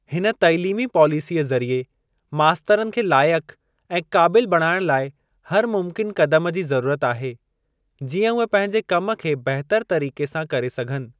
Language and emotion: Sindhi, neutral